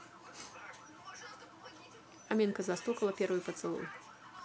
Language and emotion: Russian, neutral